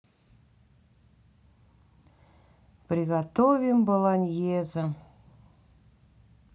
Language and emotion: Russian, sad